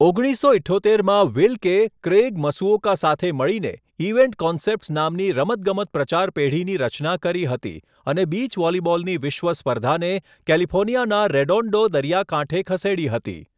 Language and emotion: Gujarati, neutral